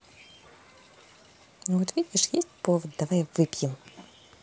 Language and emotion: Russian, positive